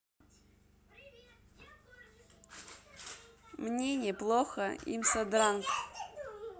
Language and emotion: Russian, neutral